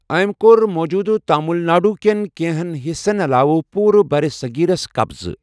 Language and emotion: Kashmiri, neutral